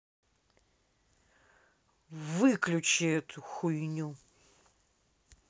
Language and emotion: Russian, angry